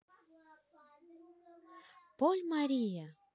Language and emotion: Russian, positive